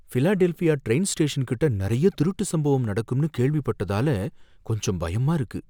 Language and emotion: Tamil, fearful